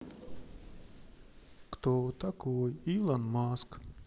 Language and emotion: Russian, neutral